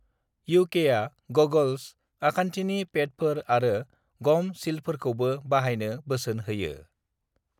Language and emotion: Bodo, neutral